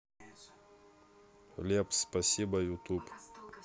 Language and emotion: Russian, neutral